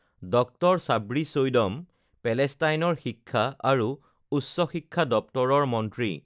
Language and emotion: Assamese, neutral